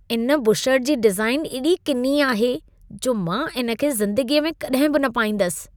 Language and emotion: Sindhi, disgusted